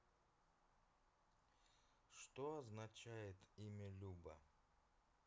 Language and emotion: Russian, neutral